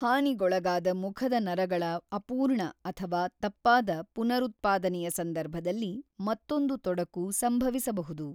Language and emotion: Kannada, neutral